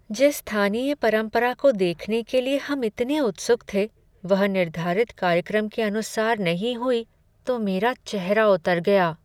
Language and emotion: Hindi, sad